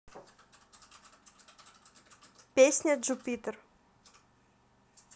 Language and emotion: Russian, neutral